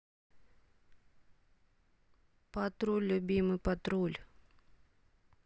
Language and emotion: Russian, neutral